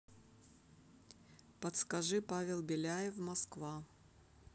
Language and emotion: Russian, neutral